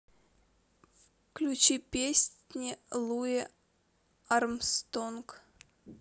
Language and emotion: Russian, neutral